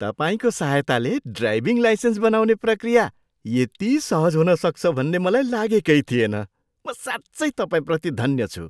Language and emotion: Nepali, surprised